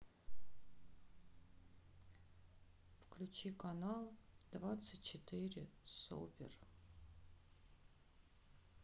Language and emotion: Russian, sad